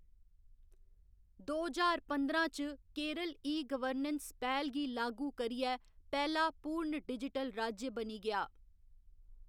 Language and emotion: Dogri, neutral